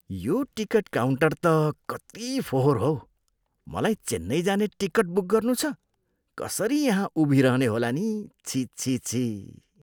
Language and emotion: Nepali, disgusted